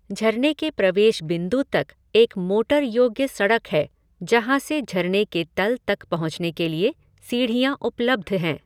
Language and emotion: Hindi, neutral